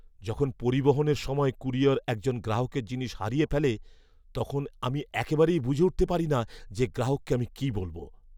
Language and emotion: Bengali, fearful